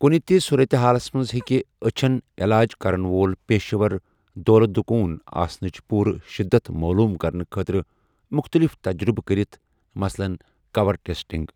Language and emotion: Kashmiri, neutral